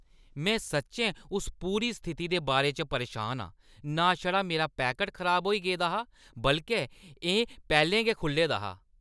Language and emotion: Dogri, angry